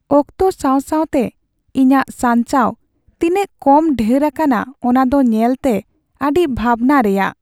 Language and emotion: Santali, sad